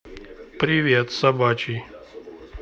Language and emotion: Russian, neutral